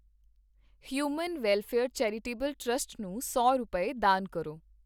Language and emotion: Punjabi, neutral